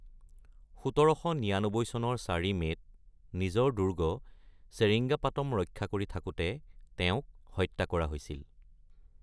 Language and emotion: Assamese, neutral